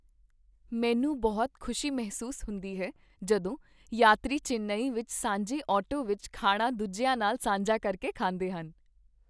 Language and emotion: Punjabi, happy